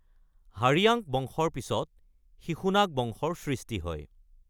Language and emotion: Assamese, neutral